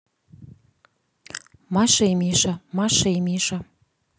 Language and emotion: Russian, neutral